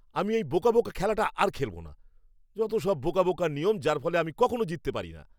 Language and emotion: Bengali, angry